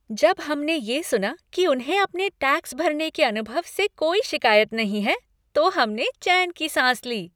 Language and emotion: Hindi, happy